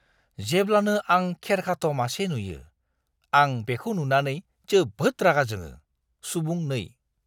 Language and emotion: Bodo, disgusted